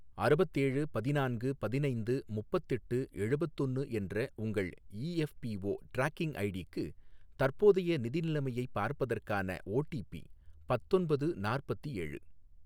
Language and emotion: Tamil, neutral